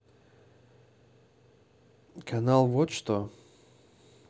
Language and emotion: Russian, neutral